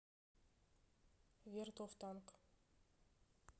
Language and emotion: Russian, neutral